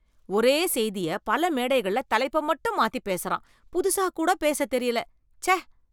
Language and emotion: Tamil, disgusted